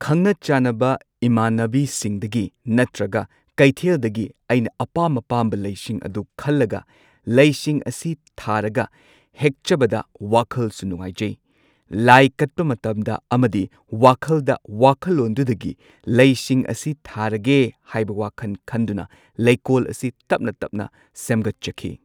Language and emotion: Manipuri, neutral